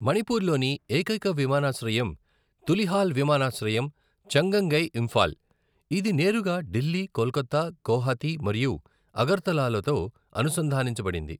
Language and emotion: Telugu, neutral